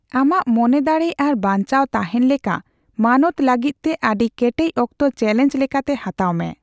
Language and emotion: Santali, neutral